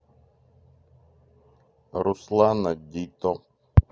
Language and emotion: Russian, neutral